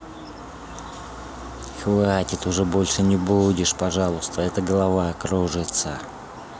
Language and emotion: Russian, neutral